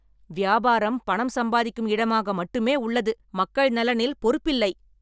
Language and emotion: Tamil, angry